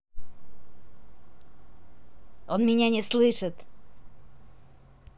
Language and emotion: Russian, neutral